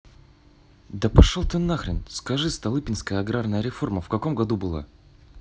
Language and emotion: Russian, angry